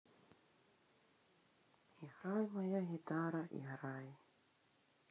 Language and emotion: Russian, sad